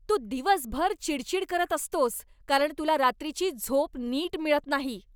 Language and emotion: Marathi, angry